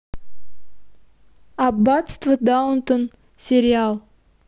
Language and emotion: Russian, neutral